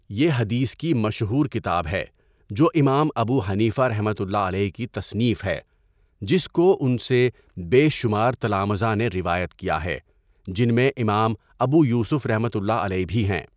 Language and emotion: Urdu, neutral